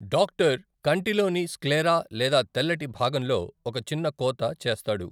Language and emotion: Telugu, neutral